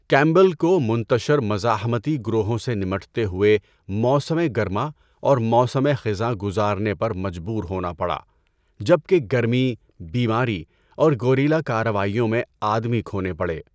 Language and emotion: Urdu, neutral